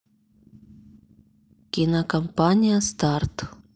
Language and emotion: Russian, neutral